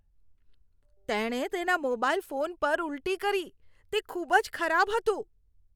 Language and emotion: Gujarati, disgusted